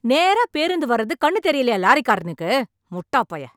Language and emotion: Tamil, angry